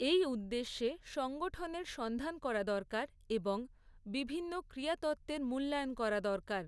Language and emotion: Bengali, neutral